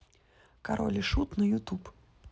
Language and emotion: Russian, neutral